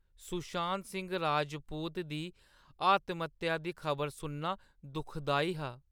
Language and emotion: Dogri, sad